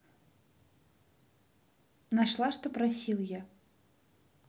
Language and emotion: Russian, neutral